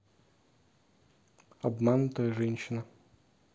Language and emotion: Russian, neutral